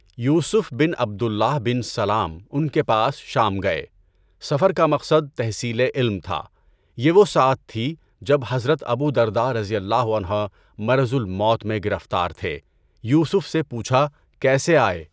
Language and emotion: Urdu, neutral